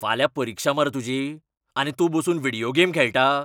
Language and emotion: Goan Konkani, angry